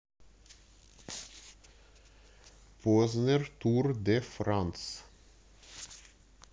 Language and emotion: Russian, neutral